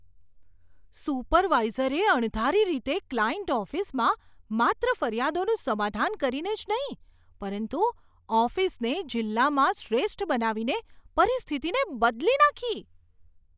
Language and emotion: Gujarati, surprised